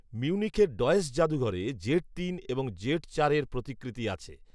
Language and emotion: Bengali, neutral